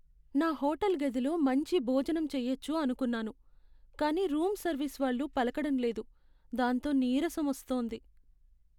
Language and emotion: Telugu, sad